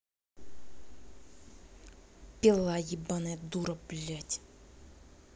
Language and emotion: Russian, angry